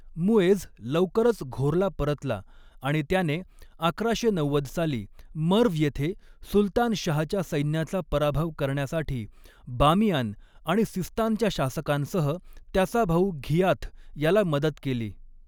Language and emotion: Marathi, neutral